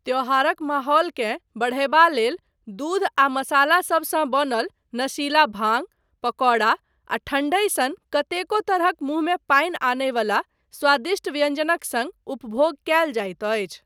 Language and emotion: Maithili, neutral